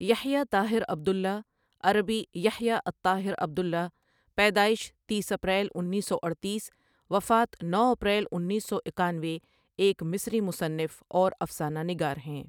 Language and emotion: Urdu, neutral